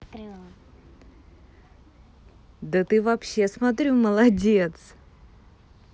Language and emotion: Russian, positive